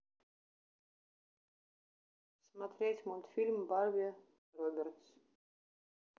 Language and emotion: Russian, neutral